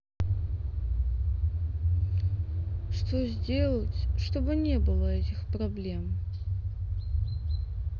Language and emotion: Russian, sad